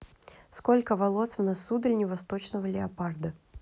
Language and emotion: Russian, neutral